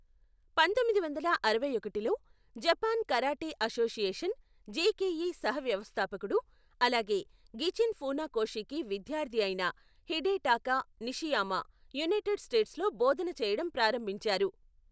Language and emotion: Telugu, neutral